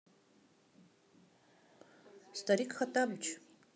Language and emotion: Russian, neutral